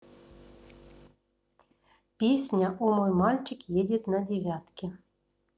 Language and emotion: Russian, neutral